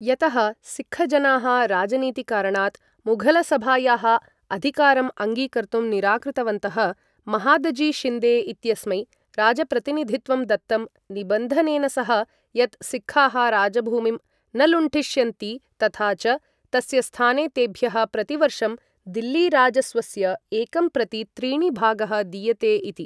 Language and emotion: Sanskrit, neutral